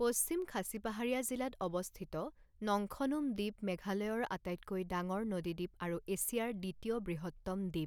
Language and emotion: Assamese, neutral